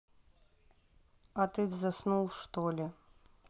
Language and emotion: Russian, neutral